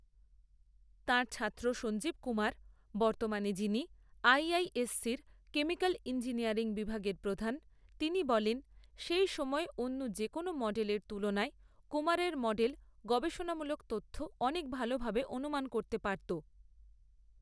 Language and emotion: Bengali, neutral